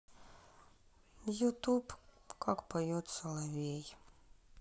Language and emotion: Russian, sad